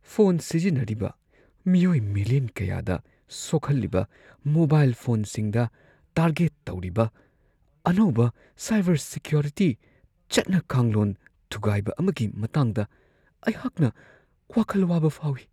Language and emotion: Manipuri, fearful